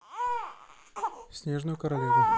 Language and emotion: Russian, neutral